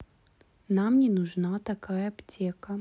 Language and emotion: Russian, neutral